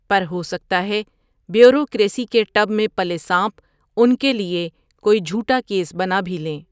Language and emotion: Urdu, neutral